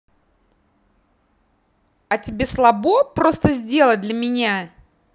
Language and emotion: Russian, angry